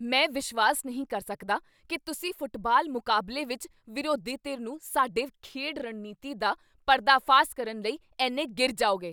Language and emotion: Punjabi, angry